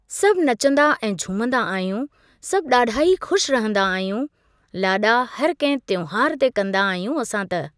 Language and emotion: Sindhi, neutral